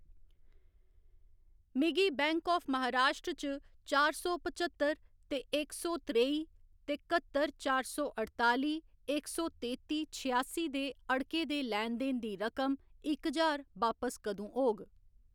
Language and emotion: Dogri, neutral